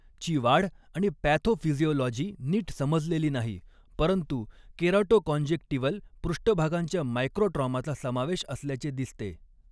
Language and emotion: Marathi, neutral